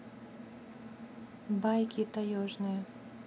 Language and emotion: Russian, neutral